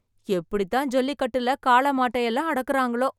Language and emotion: Tamil, surprised